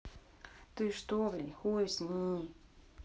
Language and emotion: Russian, neutral